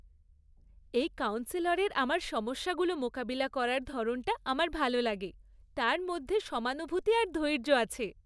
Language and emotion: Bengali, happy